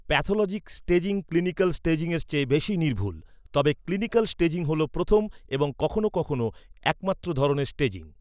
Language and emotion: Bengali, neutral